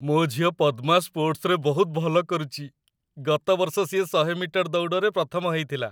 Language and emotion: Odia, happy